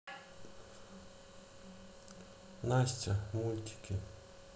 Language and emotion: Russian, sad